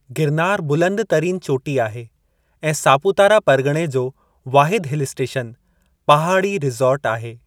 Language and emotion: Sindhi, neutral